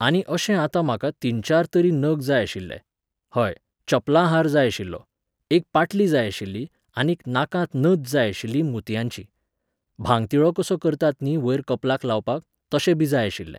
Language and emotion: Goan Konkani, neutral